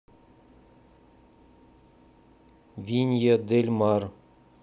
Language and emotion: Russian, neutral